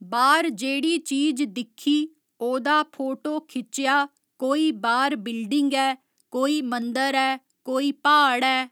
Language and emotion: Dogri, neutral